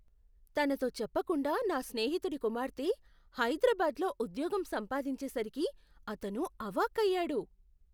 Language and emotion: Telugu, surprised